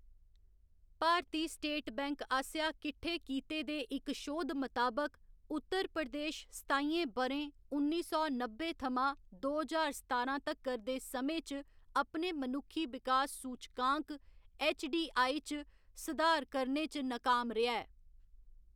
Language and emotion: Dogri, neutral